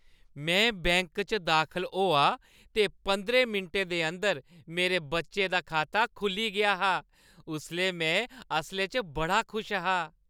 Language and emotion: Dogri, happy